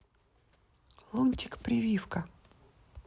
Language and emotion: Russian, neutral